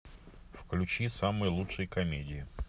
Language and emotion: Russian, neutral